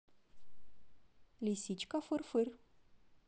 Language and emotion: Russian, positive